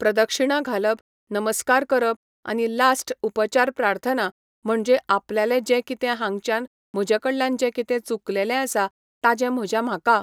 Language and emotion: Goan Konkani, neutral